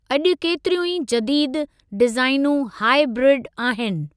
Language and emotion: Sindhi, neutral